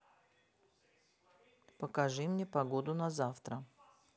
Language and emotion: Russian, neutral